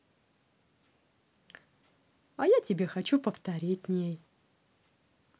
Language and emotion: Russian, positive